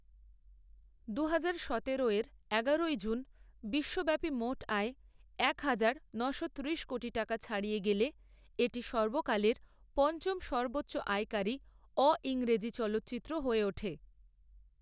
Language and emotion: Bengali, neutral